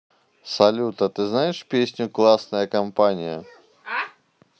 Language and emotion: Russian, neutral